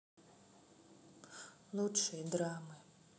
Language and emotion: Russian, neutral